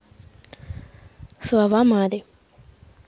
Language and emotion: Russian, neutral